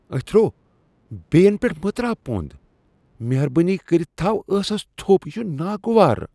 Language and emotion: Kashmiri, disgusted